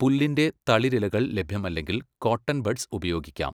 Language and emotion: Malayalam, neutral